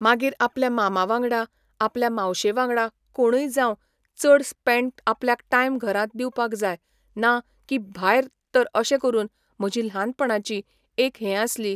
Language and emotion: Goan Konkani, neutral